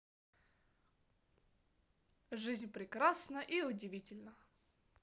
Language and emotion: Russian, positive